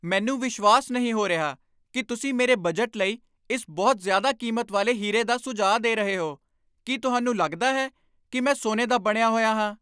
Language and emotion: Punjabi, angry